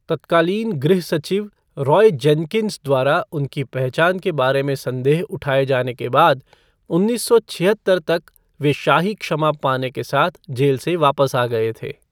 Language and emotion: Hindi, neutral